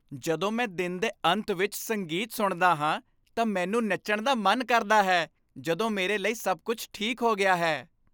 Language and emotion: Punjabi, happy